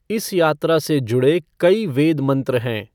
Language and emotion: Hindi, neutral